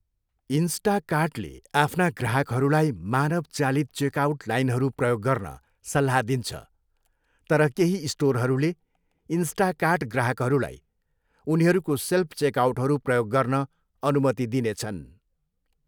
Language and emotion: Nepali, neutral